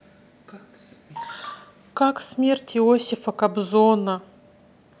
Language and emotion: Russian, neutral